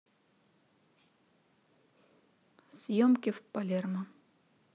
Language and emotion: Russian, neutral